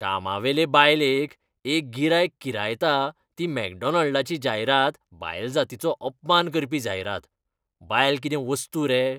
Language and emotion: Goan Konkani, disgusted